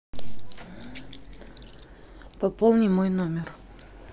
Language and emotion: Russian, neutral